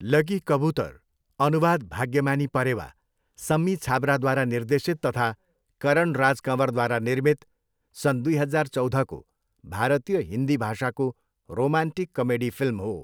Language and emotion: Nepali, neutral